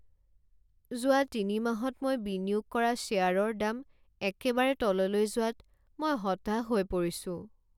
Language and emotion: Assamese, sad